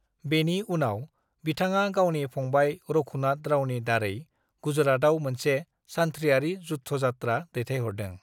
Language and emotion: Bodo, neutral